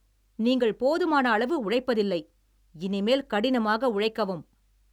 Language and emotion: Tamil, angry